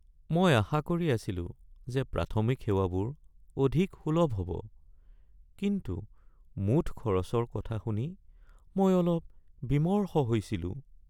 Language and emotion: Assamese, sad